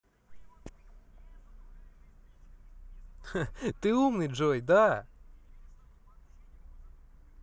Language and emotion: Russian, positive